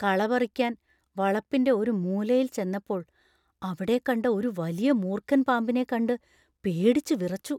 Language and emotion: Malayalam, fearful